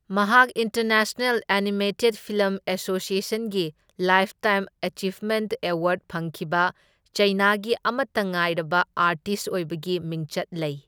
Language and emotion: Manipuri, neutral